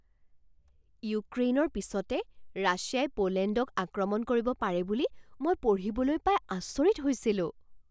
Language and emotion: Assamese, surprised